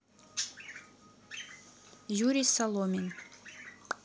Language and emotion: Russian, neutral